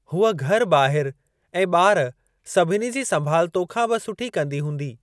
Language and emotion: Sindhi, neutral